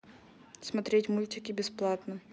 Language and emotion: Russian, neutral